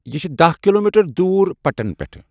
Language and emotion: Kashmiri, neutral